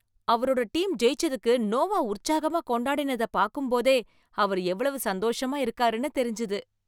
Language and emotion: Tamil, happy